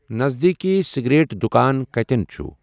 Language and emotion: Kashmiri, neutral